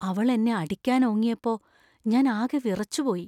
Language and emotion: Malayalam, fearful